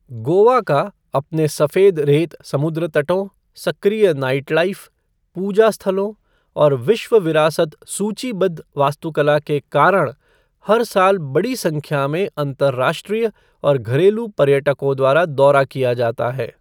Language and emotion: Hindi, neutral